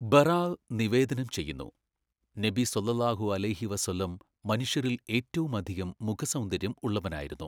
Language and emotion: Malayalam, neutral